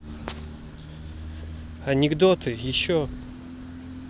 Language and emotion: Russian, neutral